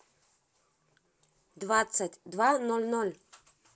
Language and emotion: Russian, positive